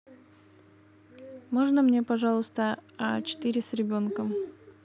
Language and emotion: Russian, neutral